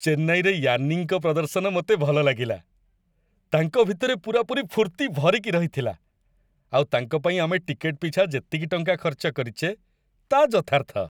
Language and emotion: Odia, happy